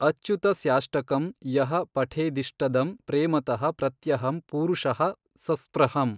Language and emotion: Kannada, neutral